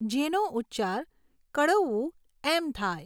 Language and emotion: Gujarati, neutral